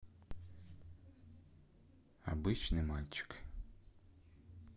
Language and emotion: Russian, neutral